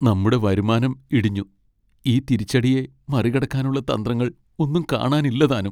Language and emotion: Malayalam, sad